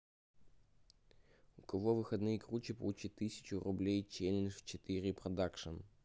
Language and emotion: Russian, neutral